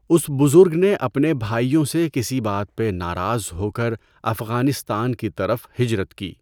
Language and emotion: Urdu, neutral